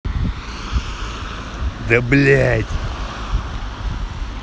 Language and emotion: Russian, angry